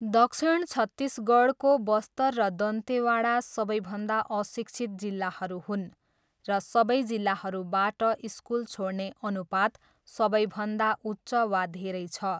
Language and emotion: Nepali, neutral